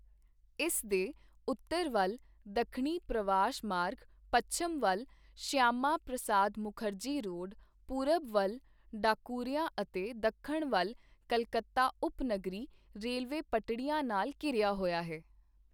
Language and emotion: Punjabi, neutral